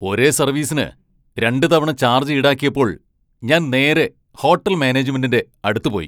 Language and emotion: Malayalam, angry